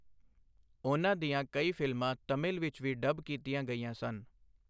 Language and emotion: Punjabi, neutral